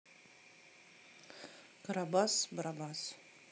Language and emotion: Russian, neutral